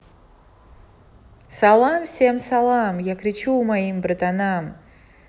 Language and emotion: Russian, positive